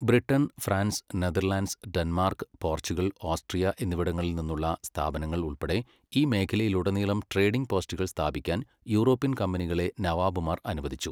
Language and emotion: Malayalam, neutral